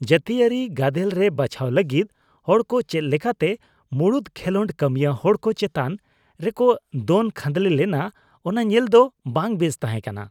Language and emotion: Santali, disgusted